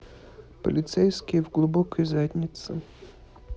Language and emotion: Russian, neutral